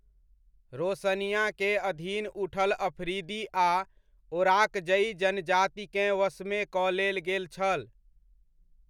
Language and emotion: Maithili, neutral